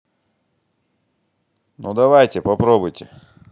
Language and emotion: Russian, angry